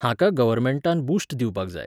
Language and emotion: Goan Konkani, neutral